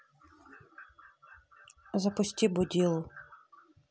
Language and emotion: Russian, neutral